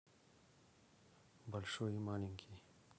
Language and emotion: Russian, neutral